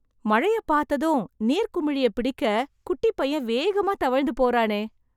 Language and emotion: Tamil, surprised